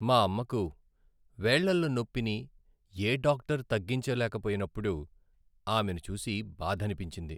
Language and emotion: Telugu, sad